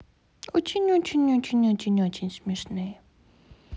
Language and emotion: Russian, positive